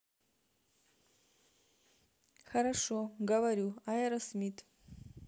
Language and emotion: Russian, neutral